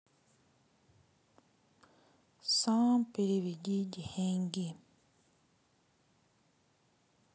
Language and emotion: Russian, sad